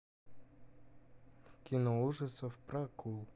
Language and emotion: Russian, neutral